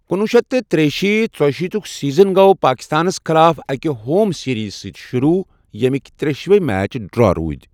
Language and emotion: Kashmiri, neutral